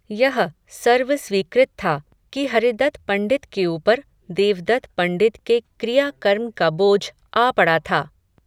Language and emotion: Hindi, neutral